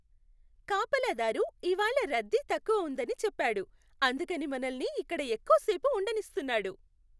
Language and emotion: Telugu, happy